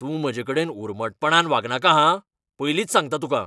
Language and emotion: Goan Konkani, angry